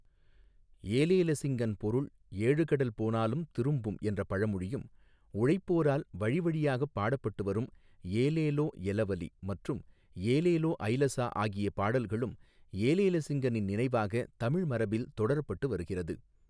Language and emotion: Tamil, neutral